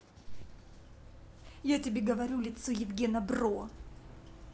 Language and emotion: Russian, angry